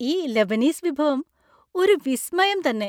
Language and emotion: Malayalam, happy